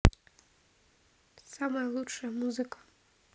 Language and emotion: Russian, neutral